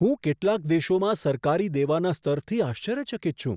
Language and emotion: Gujarati, surprised